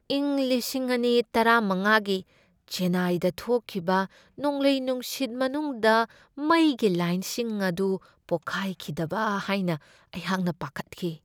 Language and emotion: Manipuri, fearful